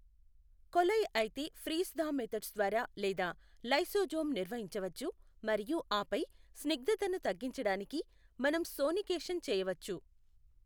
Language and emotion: Telugu, neutral